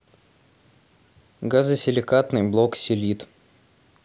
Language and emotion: Russian, neutral